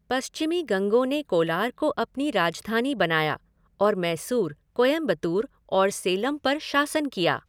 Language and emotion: Hindi, neutral